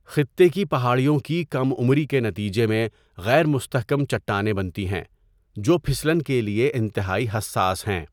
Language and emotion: Urdu, neutral